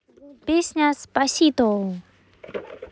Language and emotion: Russian, positive